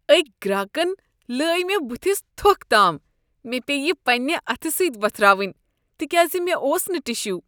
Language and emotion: Kashmiri, disgusted